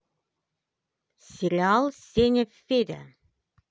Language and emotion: Russian, positive